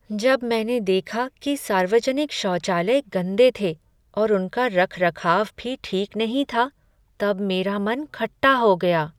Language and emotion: Hindi, sad